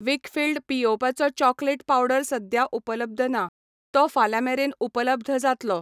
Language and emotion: Goan Konkani, neutral